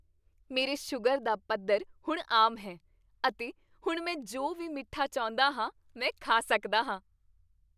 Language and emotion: Punjabi, happy